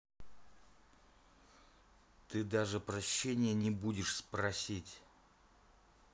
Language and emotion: Russian, neutral